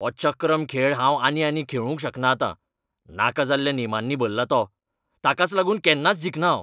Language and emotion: Goan Konkani, angry